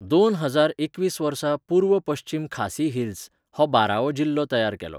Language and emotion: Goan Konkani, neutral